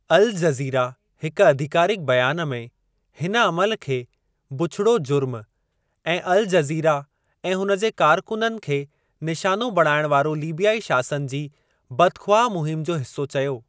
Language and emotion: Sindhi, neutral